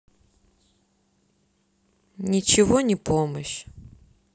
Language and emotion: Russian, sad